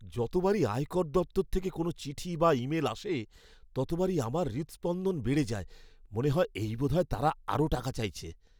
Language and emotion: Bengali, fearful